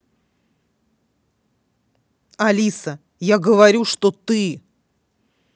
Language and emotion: Russian, angry